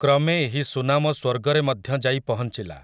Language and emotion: Odia, neutral